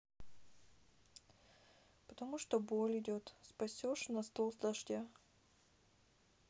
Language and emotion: Russian, sad